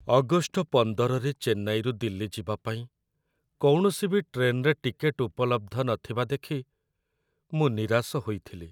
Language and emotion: Odia, sad